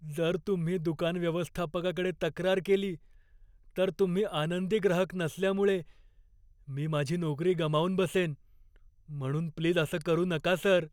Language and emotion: Marathi, fearful